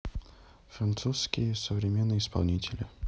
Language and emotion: Russian, neutral